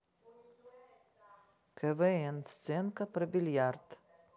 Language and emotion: Russian, neutral